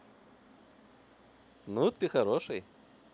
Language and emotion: Russian, positive